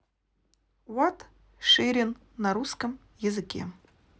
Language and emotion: Russian, neutral